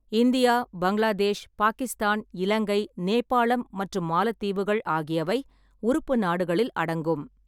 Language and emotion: Tamil, neutral